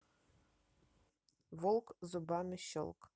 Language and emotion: Russian, neutral